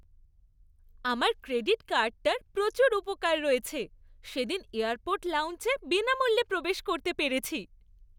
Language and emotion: Bengali, happy